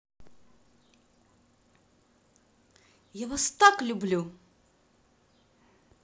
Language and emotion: Russian, positive